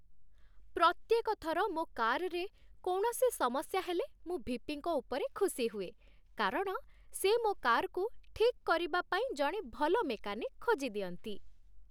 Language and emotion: Odia, happy